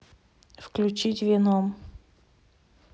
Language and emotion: Russian, neutral